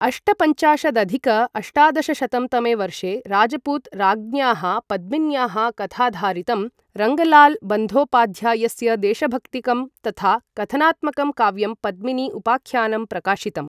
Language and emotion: Sanskrit, neutral